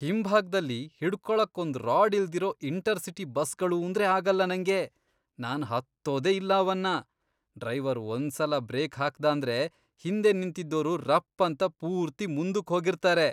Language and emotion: Kannada, disgusted